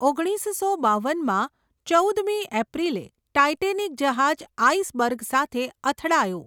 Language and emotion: Gujarati, neutral